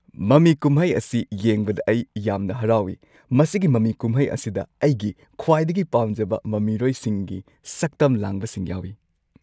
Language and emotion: Manipuri, happy